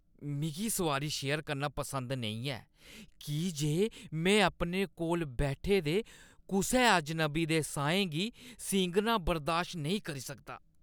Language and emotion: Dogri, disgusted